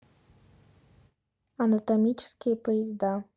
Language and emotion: Russian, neutral